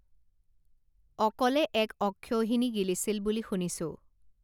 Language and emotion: Assamese, neutral